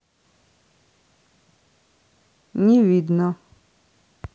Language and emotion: Russian, neutral